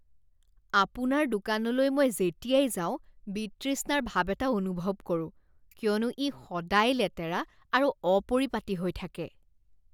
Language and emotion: Assamese, disgusted